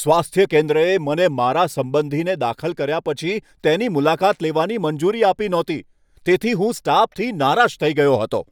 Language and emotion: Gujarati, angry